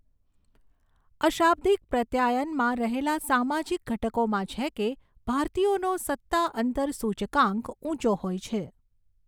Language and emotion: Gujarati, neutral